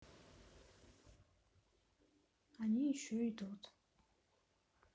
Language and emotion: Russian, sad